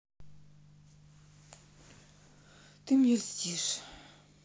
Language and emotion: Russian, sad